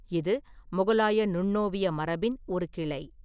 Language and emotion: Tamil, neutral